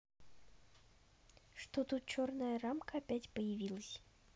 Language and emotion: Russian, neutral